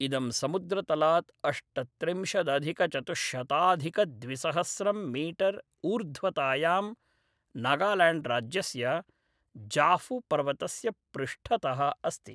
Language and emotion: Sanskrit, neutral